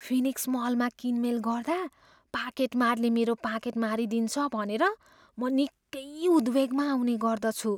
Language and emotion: Nepali, fearful